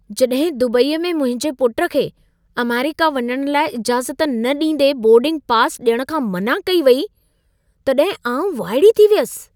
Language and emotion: Sindhi, surprised